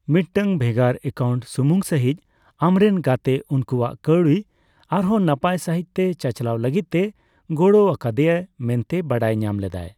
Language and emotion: Santali, neutral